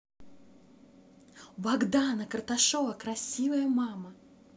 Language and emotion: Russian, positive